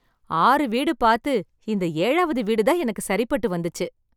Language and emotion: Tamil, happy